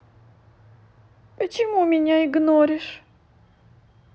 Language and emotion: Russian, sad